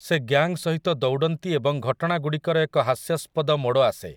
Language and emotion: Odia, neutral